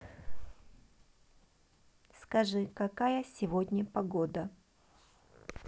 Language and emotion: Russian, neutral